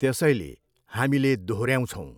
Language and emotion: Nepali, neutral